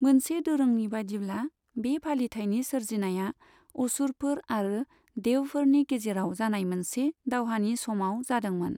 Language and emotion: Bodo, neutral